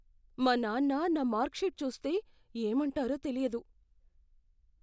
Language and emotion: Telugu, fearful